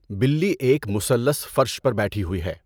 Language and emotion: Urdu, neutral